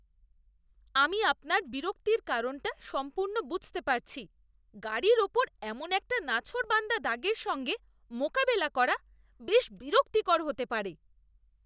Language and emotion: Bengali, disgusted